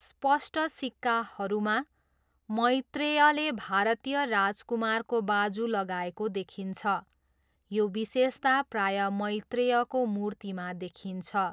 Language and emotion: Nepali, neutral